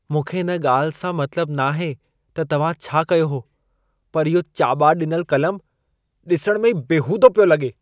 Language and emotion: Sindhi, disgusted